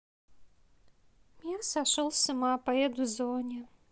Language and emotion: Russian, sad